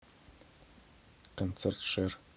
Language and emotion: Russian, neutral